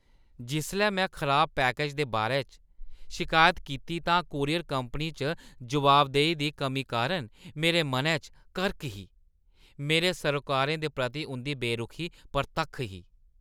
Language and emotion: Dogri, disgusted